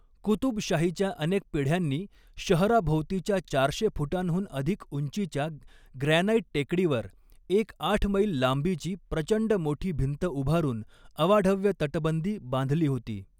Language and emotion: Marathi, neutral